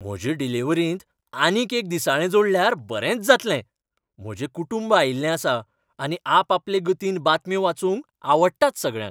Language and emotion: Goan Konkani, happy